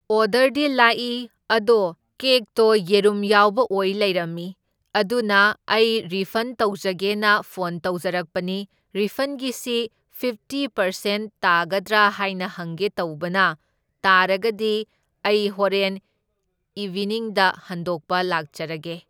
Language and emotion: Manipuri, neutral